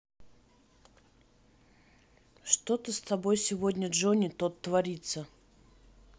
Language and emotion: Russian, neutral